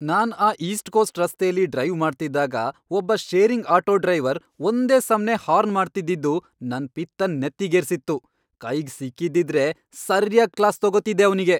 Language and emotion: Kannada, angry